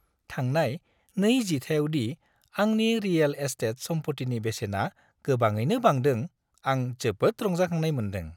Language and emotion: Bodo, happy